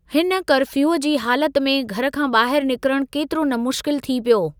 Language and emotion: Sindhi, neutral